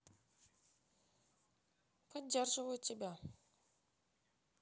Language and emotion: Russian, sad